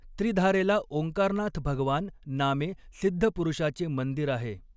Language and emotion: Marathi, neutral